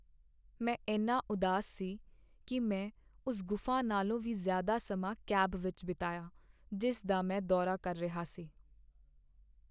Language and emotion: Punjabi, sad